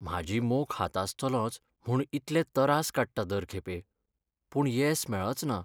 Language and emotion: Goan Konkani, sad